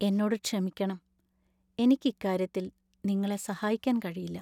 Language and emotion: Malayalam, sad